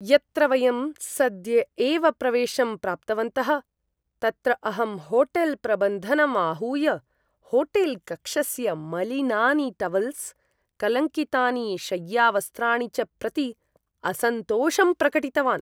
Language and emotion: Sanskrit, disgusted